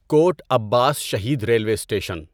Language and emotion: Urdu, neutral